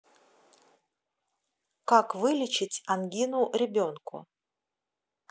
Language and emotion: Russian, neutral